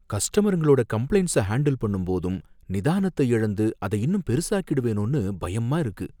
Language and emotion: Tamil, fearful